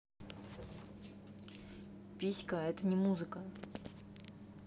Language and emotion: Russian, neutral